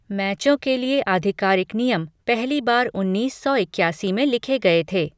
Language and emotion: Hindi, neutral